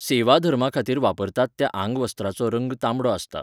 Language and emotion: Goan Konkani, neutral